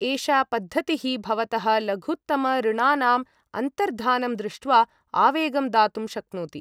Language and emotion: Sanskrit, neutral